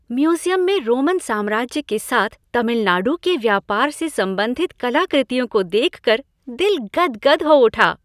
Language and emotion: Hindi, happy